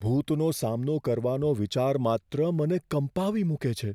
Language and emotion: Gujarati, fearful